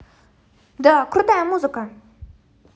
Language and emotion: Russian, positive